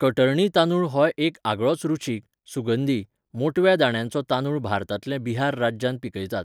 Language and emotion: Goan Konkani, neutral